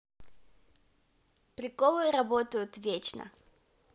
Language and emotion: Russian, positive